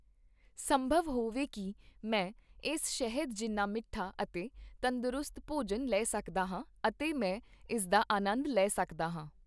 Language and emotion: Punjabi, neutral